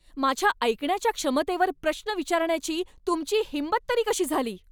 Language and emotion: Marathi, angry